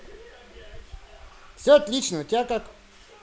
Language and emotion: Russian, positive